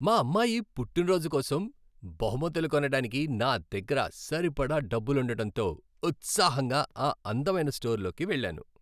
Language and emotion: Telugu, happy